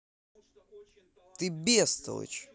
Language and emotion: Russian, angry